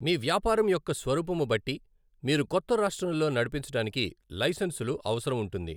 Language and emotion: Telugu, neutral